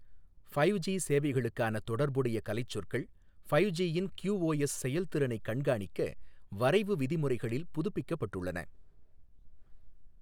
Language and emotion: Tamil, neutral